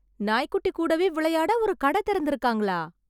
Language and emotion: Tamil, surprised